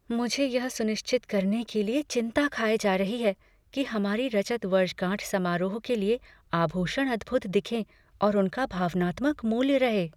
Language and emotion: Hindi, fearful